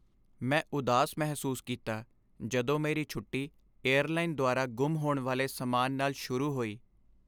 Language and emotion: Punjabi, sad